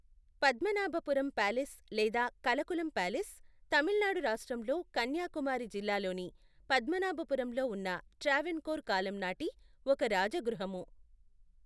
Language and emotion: Telugu, neutral